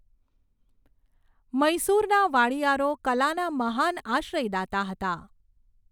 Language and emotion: Gujarati, neutral